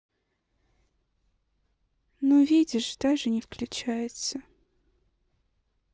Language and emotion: Russian, sad